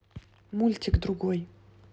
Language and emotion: Russian, neutral